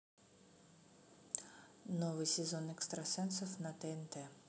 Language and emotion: Russian, neutral